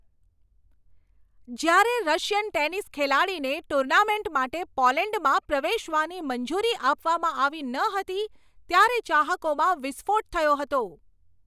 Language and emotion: Gujarati, angry